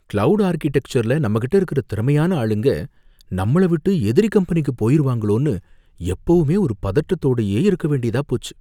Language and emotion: Tamil, fearful